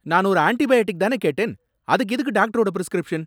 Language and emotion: Tamil, angry